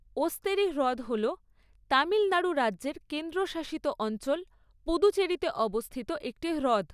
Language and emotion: Bengali, neutral